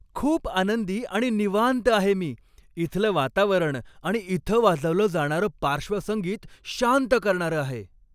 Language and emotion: Marathi, happy